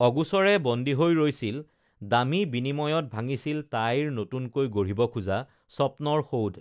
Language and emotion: Assamese, neutral